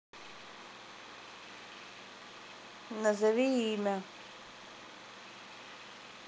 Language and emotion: Russian, neutral